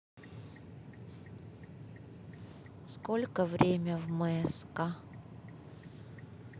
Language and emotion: Russian, neutral